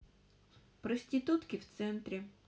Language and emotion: Russian, neutral